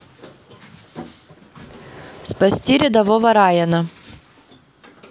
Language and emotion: Russian, neutral